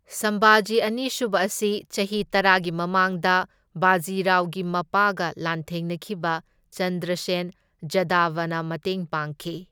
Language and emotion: Manipuri, neutral